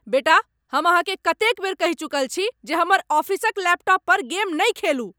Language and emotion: Maithili, angry